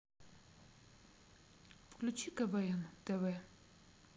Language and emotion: Russian, neutral